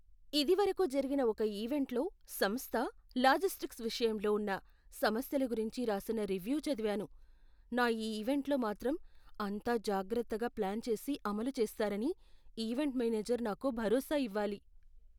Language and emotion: Telugu, fearful